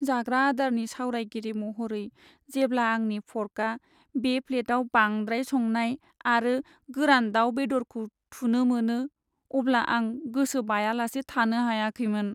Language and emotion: Bodo, sad